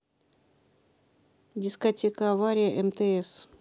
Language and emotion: Russian, neutral